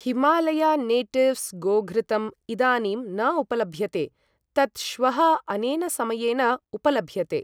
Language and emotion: Sanskrit, neutral